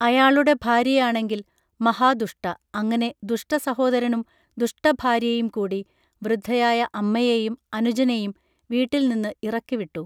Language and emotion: Malayalam, neutral